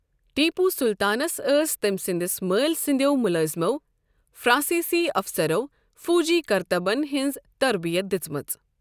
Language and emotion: Kashmiri, neutral